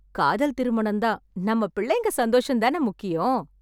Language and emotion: Tamil, happy